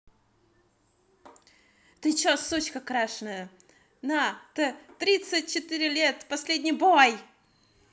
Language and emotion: Russian, angry